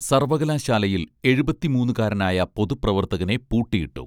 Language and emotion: Malayalam, neutral